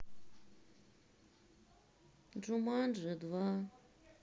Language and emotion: Russian, sad